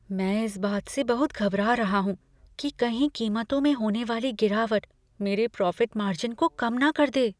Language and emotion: Hindi, fearful